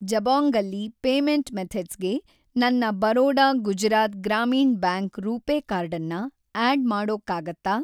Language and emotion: Kannada, neutral